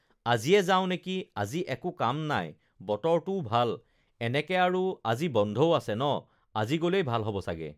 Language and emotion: Assamese, neutral